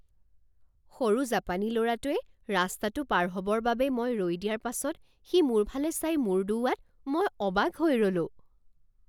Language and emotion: Assamese, surprised